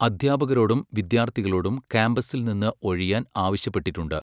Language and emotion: Malayalam, neutral